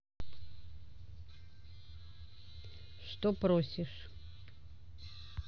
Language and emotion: Russian, neutral